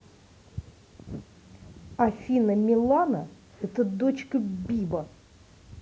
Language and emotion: Russian, angry